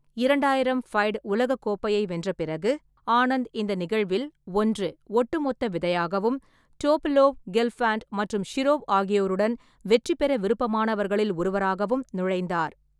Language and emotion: Tamil, neutral